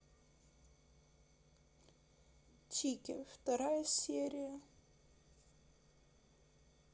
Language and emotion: Russian, sad